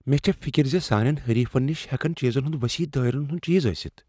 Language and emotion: Kashmiri, fearful